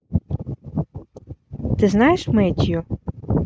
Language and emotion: Russian, neutral